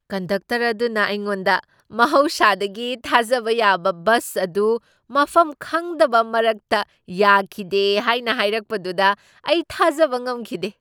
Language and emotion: Manipuri, surprised